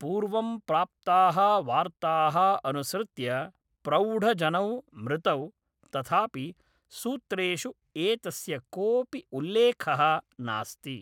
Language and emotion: Sanskrit, neutral